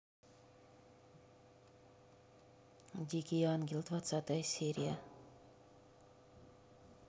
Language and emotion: Russian, neutral